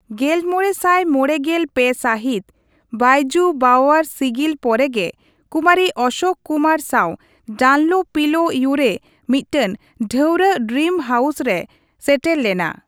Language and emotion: Santali, neutral